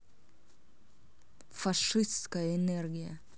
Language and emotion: Russian, angry